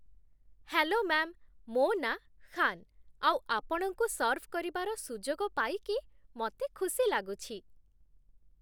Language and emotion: Odia, happy